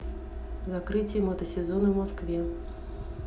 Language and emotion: Russian, neutral